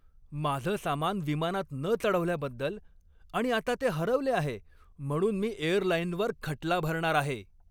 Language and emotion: Marathi, angry